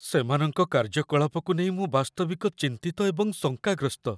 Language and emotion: Odia, fearful